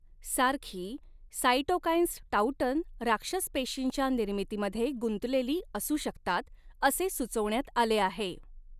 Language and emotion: Marathi, neutral